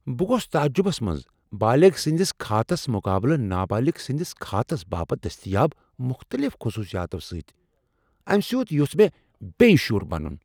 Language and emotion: Kashmiri, surprised